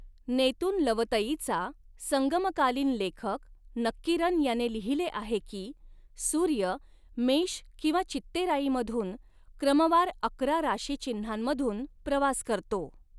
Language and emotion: Marathi, neutral